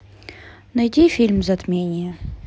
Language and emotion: Russian, neutral